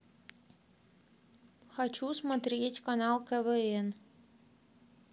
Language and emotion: Russian, neutral